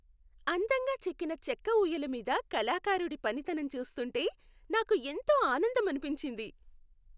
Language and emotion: Telugu, happy